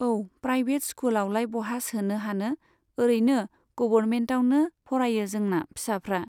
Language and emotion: Bodo, neutral